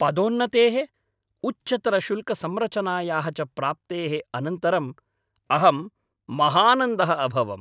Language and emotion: Sanskrit, happy